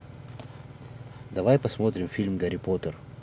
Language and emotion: Russian, neutral